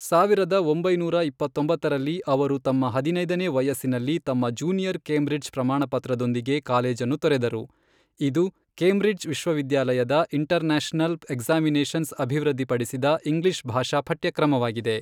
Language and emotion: Kannada, neutral